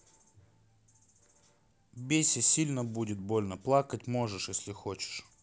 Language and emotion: Russian, neutral